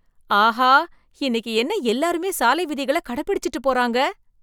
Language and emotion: Tamil, surprised